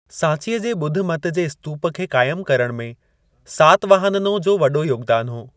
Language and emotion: Sindhi, neutral